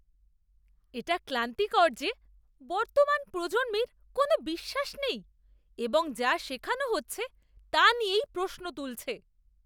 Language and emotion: Bengali, disgusted